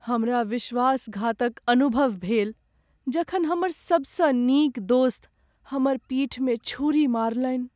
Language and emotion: Maithili, sad